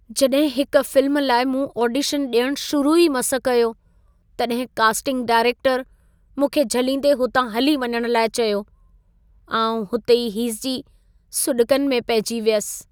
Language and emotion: Sindhi, sad